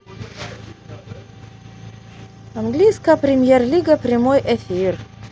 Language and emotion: Russian, positive